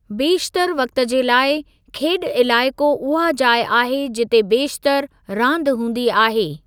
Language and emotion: Sindhi, neutral